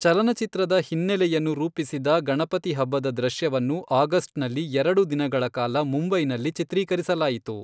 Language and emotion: Kannada, neutral